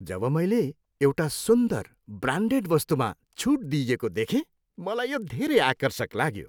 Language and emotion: Nepali, happy